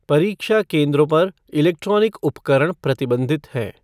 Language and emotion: Hindi, neutral